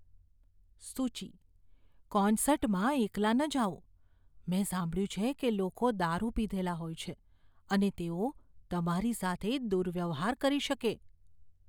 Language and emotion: Gujarati, fearful